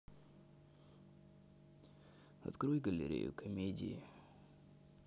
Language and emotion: Russian, neutral